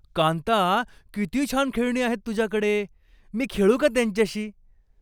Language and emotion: Marathi, happy